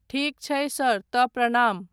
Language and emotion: Maithili, neutral